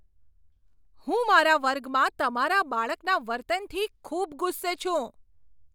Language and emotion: Gujarati, angry